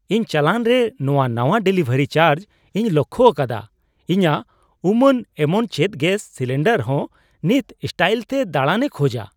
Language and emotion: Santali, surprised